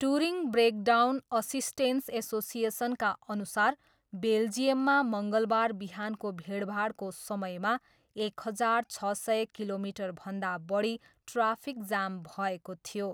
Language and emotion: Nepali, neutral